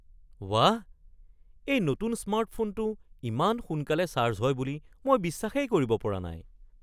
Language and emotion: Assamese, surprised